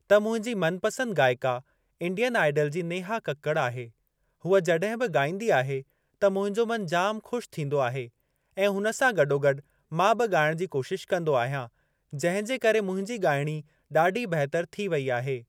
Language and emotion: Sindhi, neutral